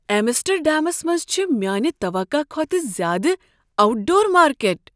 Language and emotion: Kashmiri, surprised